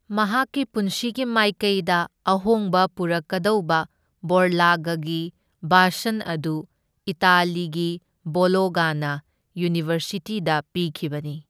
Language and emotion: Manipuri, neutral